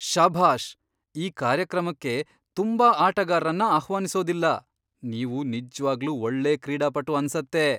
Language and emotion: Kannada, surprised